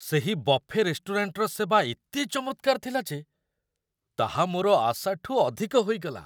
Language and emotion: Odia, surprised